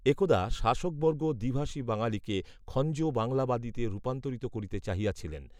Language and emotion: Bengali, neutral